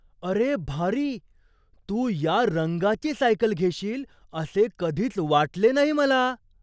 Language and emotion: Marathi, surprised